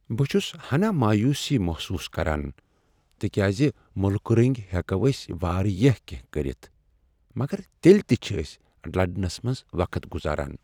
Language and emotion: Kashmiri, sad